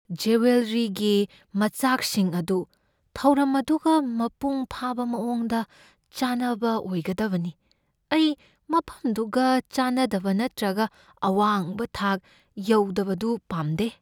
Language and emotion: Manipuri, fearful